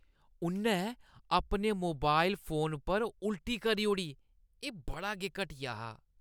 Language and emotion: Dogri, disgusted